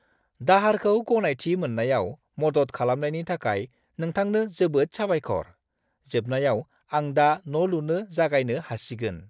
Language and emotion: Bodo, happy